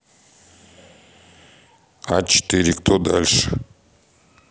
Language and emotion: Russian, neutral